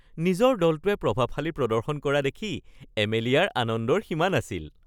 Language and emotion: Assamese, happy